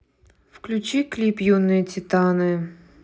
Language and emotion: Russian, neutral